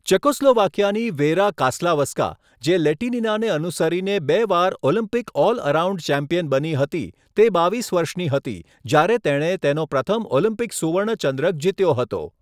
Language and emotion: Gujarati, neutral